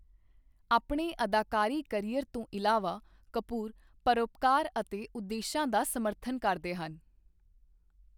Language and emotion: Punjabi, neutral